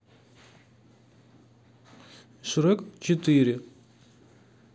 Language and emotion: Russian, neutral